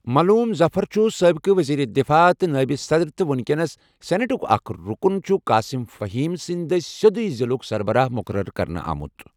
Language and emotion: Kashmiri, neutral